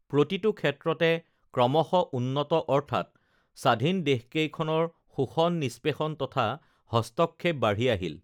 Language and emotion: Assamese, neutral